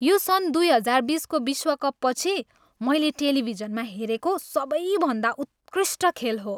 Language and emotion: Nepali, happy